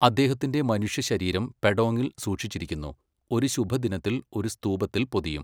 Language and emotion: Malayalam, neutral